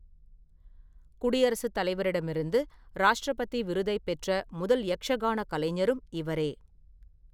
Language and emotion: Tamil, neutral